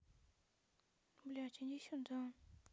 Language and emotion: Russian, neutral